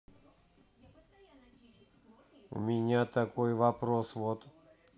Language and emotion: Russian, neutral